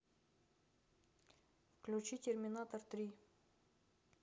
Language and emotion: Russian, neutral